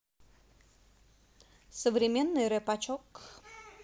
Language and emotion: Russian, positive